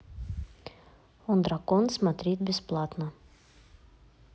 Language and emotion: Russian, neutral